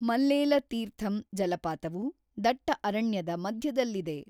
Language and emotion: Kannada, neutral